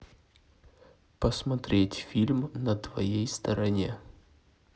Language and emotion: Russian, neutral